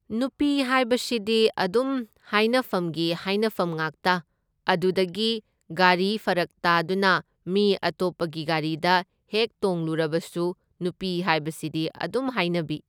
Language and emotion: Manipuri, neutral